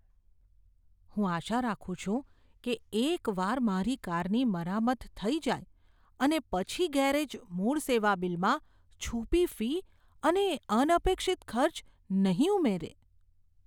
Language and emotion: Gujarati, fearful